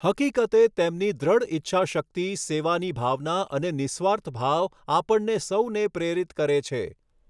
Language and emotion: Gujarati, neutral